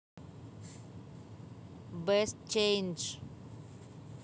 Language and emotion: Russian, neutral